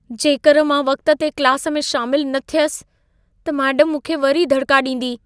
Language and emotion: Sindhi, fearful